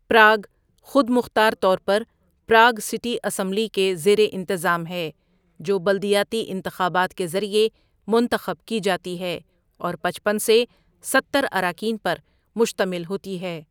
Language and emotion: Urdu, neutral